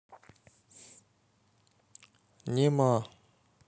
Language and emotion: Russian, neutral